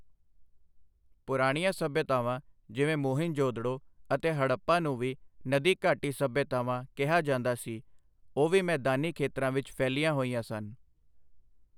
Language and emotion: Punjabi, neutral